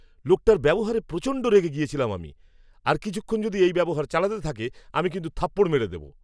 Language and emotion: Bengali, angry